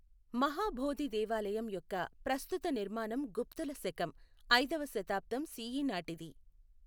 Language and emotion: Telugu, neutral